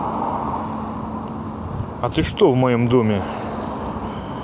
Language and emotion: Russian, neutral